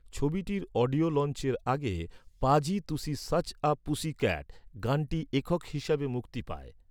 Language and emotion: Bengali, neutral